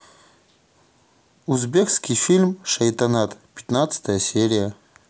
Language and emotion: Russian, neutral